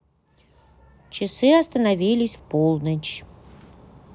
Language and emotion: Russian, neutral